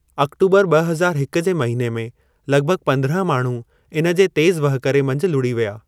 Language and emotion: Sindhi, neutral